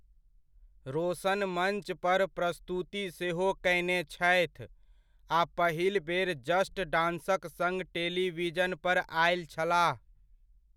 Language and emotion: Maithili, neutral